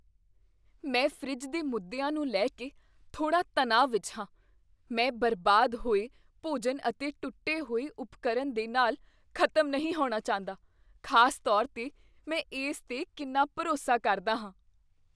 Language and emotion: Punjabi, fearful